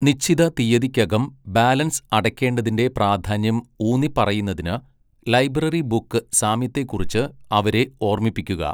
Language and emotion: Malayalam, neutral